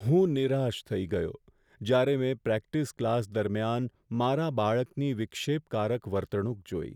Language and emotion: Gujarati, sad